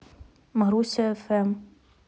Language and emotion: Russian, neutral